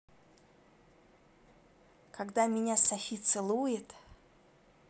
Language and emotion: Russian, positive